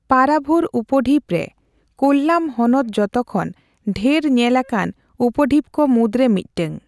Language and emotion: Santali, neutral